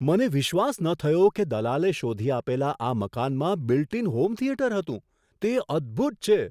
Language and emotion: Gujarati, surprised